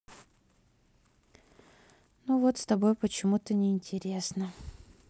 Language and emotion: Russian, sad